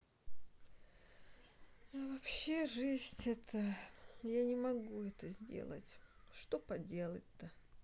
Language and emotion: Russian, sad